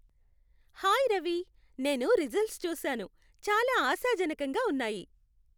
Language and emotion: Telugu, happy